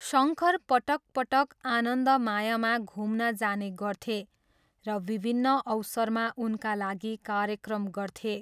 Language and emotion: Nepali, neutral